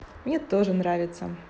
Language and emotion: Russian, positive